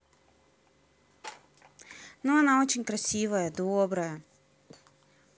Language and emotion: Russian, positive